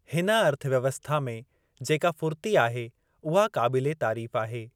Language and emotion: Sindhi, neutral